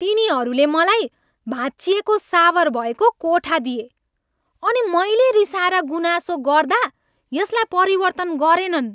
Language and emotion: Nepali, angry